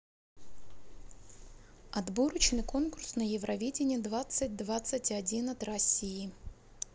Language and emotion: Russian, neutral